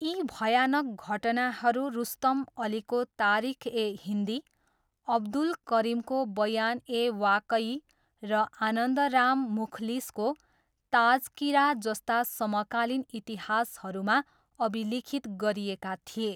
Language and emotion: Nepali, neutral